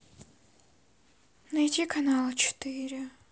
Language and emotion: Russian, sad